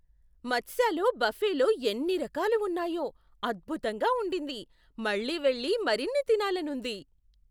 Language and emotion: Telugu, surprised